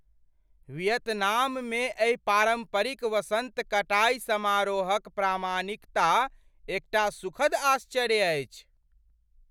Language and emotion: Maithili, surprised